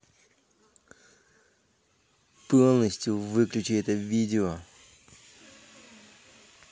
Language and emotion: Russian, angry